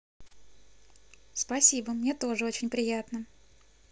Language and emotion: Russian, positive